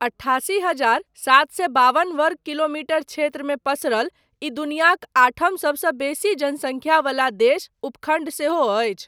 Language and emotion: Maithili, neutral